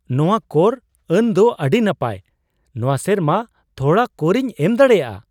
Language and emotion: Santali, surprised